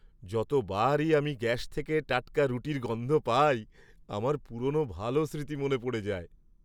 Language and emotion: Bengali, happy